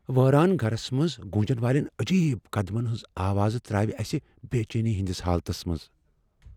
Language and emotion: Kashmiri, fearful